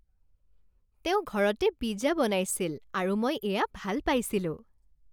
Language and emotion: Assamese, happy